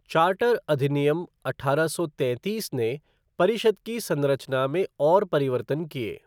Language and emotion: Hindi, neutral